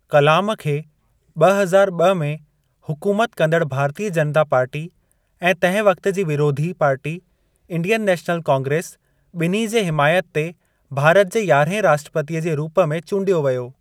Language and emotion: Sindhi, neutral